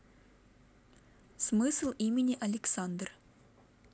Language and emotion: Russian, neutral